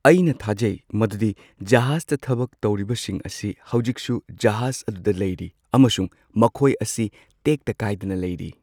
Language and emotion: Manipuri, neutral